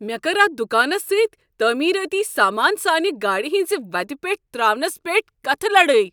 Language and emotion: Kashmiri, angry